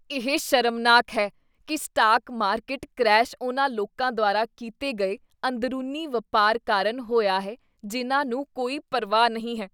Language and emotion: Punjabi, disgusted